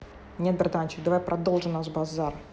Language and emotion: Russian, angry